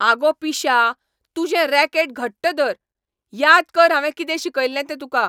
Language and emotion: Goan Konkani, angry